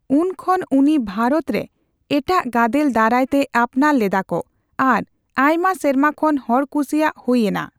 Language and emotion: Santali, neutral